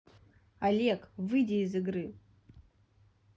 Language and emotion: Russian, neutral